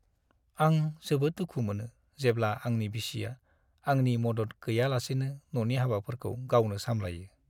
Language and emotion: Bodo, sad